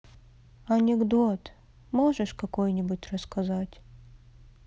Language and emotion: Russian, sad